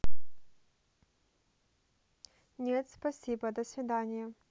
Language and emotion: Russian, neutral